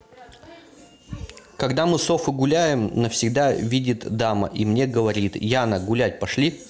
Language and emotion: Russian, neutral